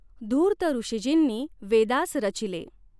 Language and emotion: Marathi, neutral